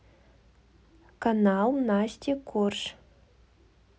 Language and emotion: Russian, neutral